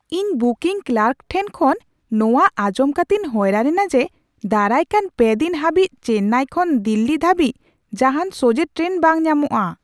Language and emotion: Santali, surprised